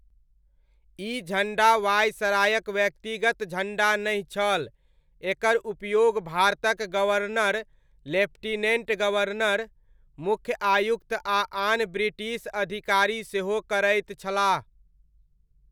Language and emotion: Maithili, neutral